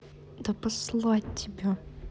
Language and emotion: Russian, angry